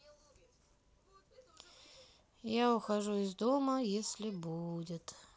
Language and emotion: Russian, sad